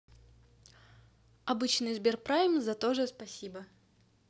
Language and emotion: Russian, neutral